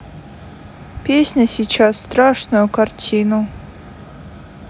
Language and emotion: Russian, sad